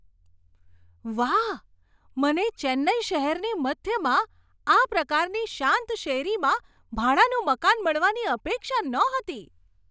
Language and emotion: Gujarati, surprised